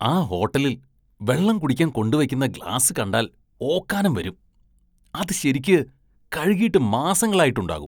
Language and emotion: Malayalam, disgusted